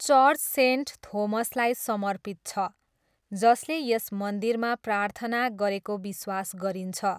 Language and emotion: Nepali, neutral